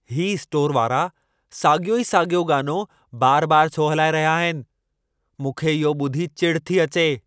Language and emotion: Sindhi, angry